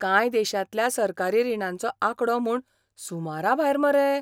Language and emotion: Goan Konkani, surprised